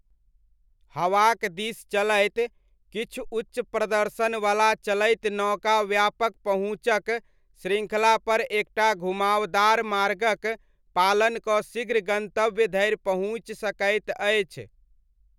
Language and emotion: Maithili, neutral